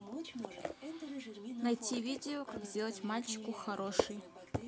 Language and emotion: Russian, neutral